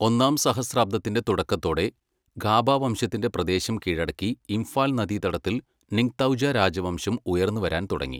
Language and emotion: Malayalam, neutral